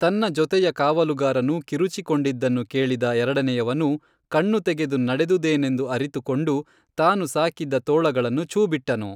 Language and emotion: Kannada, neutral